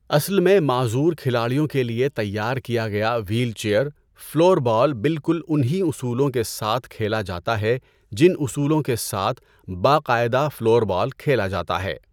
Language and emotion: Urdu, neutral